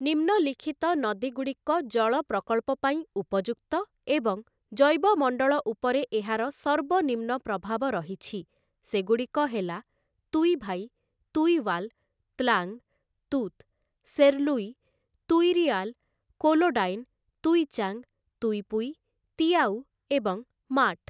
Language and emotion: Odia, neutral